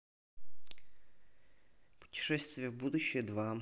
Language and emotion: Russian, neutral